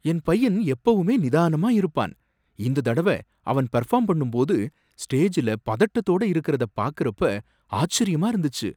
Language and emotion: Tamil, surprised